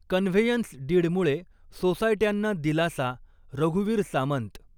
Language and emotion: Marathi, neutral